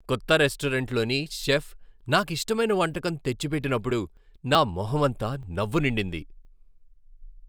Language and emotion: Telugu, happy